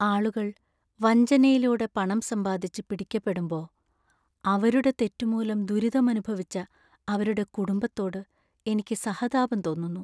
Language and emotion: Malayalam, sad